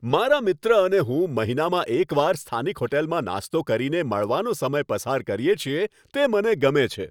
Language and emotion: Gujarati, happy